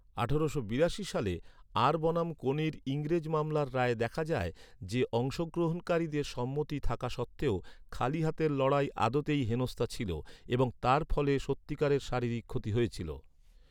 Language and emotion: Bengali, neutral